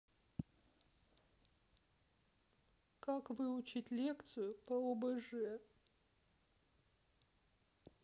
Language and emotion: Russian, sad